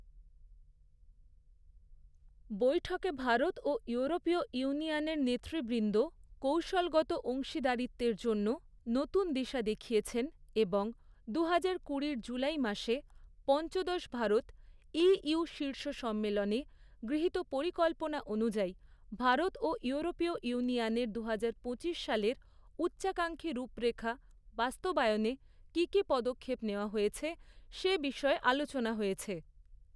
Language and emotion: Bengali, neutral